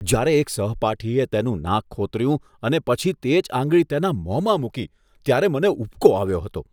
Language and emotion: Gujarati, disgusted